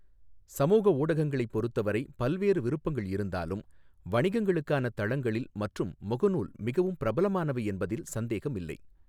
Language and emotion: Tamil, neutral